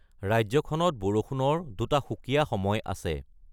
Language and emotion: Assamese, neutral